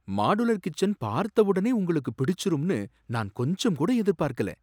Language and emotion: Tamil, surprised